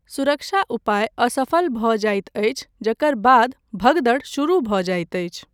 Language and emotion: Maithili, neutral